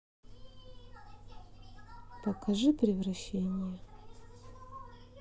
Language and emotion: Russian, neutral